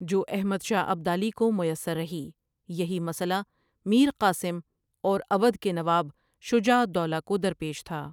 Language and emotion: Urdu, neutral